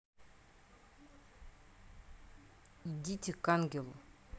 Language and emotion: Russian, neutral